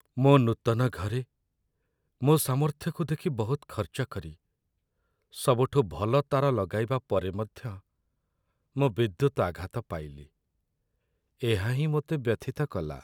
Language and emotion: Odia, sad